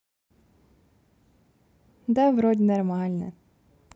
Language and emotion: Russian, positive